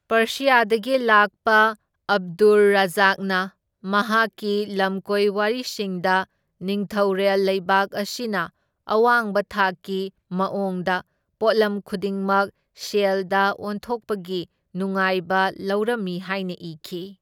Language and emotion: Manipuri, neutral